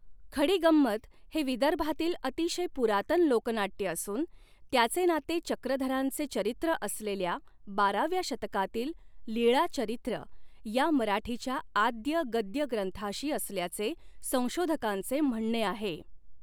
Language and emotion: Marathi, neutral